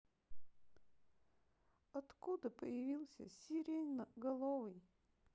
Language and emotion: Russian, sad